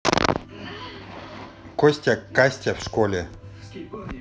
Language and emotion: Russian, neutral